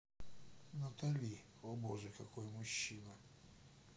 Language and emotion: Russian, neutral